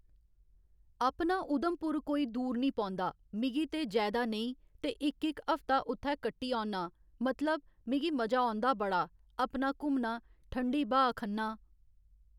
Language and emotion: Dogri, neutral